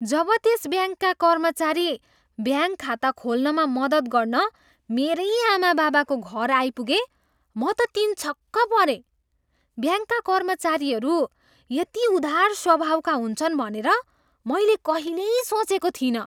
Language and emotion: Nepali, surprised